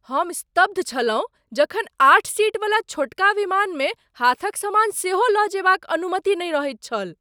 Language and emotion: Maithili, surprised